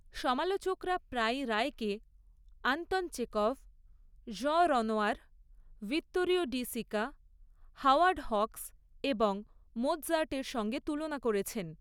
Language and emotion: Bengali, neutral